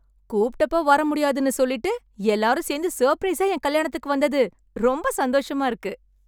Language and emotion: Tamil, happy